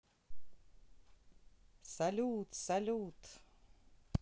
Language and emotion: Russian, positive